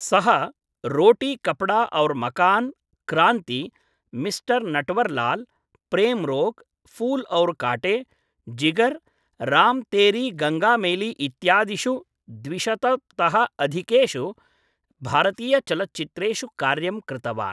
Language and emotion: Sanskrit, neutral